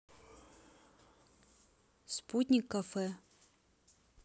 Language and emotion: Russian, neutral